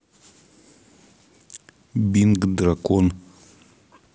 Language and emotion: Russian, neutral